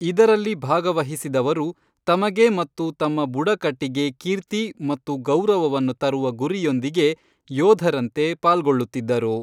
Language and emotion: Kannada, neutral